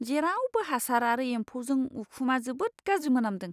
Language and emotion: Bodo, disgusted